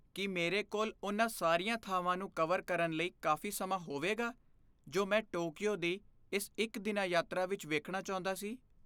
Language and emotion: Punjabi, fearful